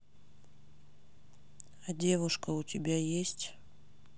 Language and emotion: Russian, neutral